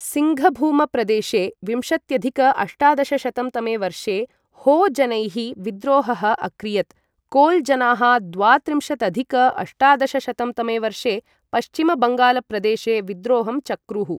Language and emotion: Sanskrit, neutral